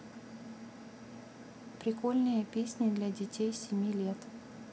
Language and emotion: Russian, neutral